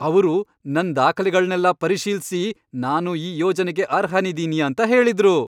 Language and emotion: Kannada, happy